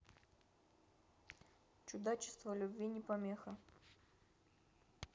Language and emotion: Russian, neutral